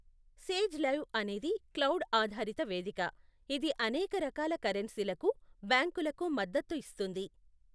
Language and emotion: Telugu, neutral